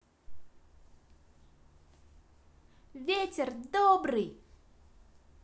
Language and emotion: Russian, positive